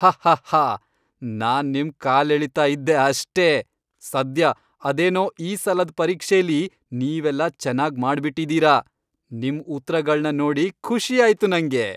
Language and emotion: Kannada, happy